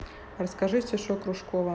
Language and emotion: Russian, neutral